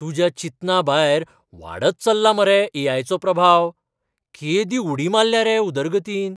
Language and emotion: Goan Konkani, surprised